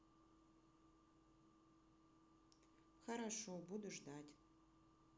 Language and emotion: Russian, sad